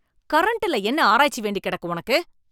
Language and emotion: Tamil, angry